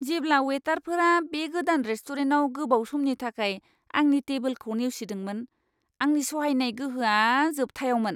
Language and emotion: Bodo, disgusted